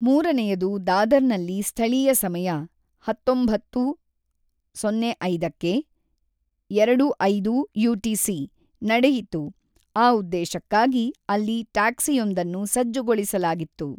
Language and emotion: Kannada, neutral